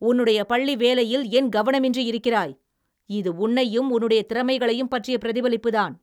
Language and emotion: Tamil, angry